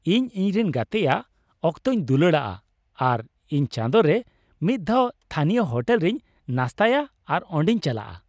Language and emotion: Santali, happy